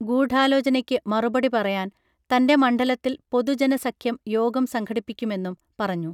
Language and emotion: Malayalam, neutral